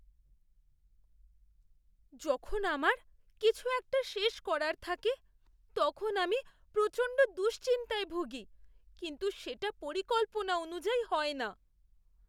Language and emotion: Bengali, fearful